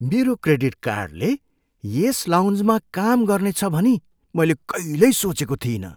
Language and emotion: Nepali, surprised